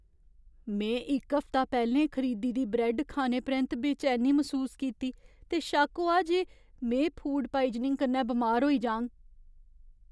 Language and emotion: Dogri, fearful